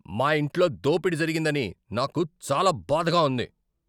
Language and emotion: Telugu, angry